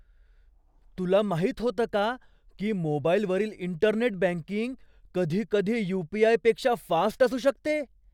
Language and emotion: Marathi, surprised